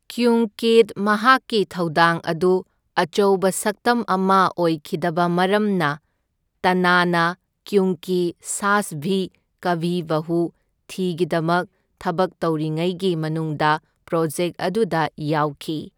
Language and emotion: Manipuri, neutral